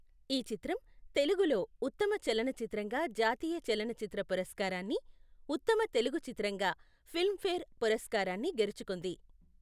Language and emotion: Telugu, neutral